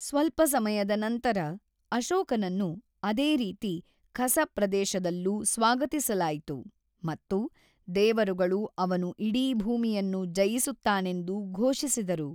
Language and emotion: Kannada, neutral